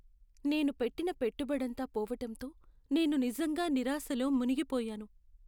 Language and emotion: Telugu, sad